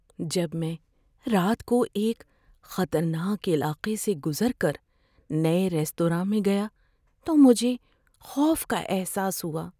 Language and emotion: Urdu, fearful